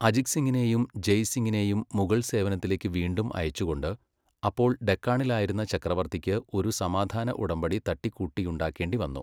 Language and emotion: Malayalam, neutral